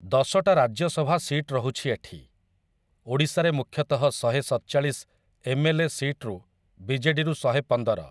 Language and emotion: Odia, neutral